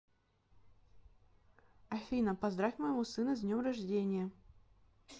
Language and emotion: Russian, neutral